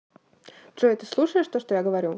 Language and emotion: Russian, neutral